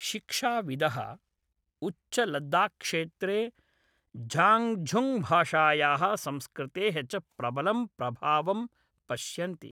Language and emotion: Sanskrit, neutral